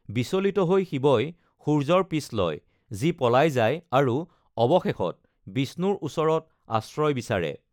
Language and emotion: Assamese, neutral